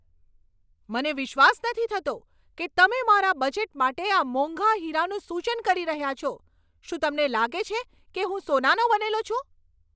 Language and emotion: Gujarati, angry